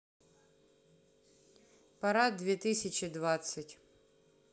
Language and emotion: Russian, neutral